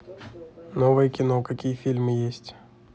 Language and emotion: Russian, neutral